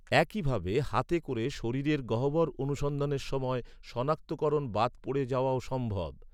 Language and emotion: Bengali, neutral